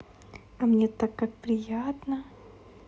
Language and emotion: Russian, positive